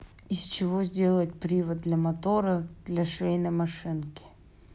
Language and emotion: Russian, neutral